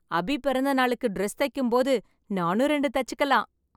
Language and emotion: Tamil, happy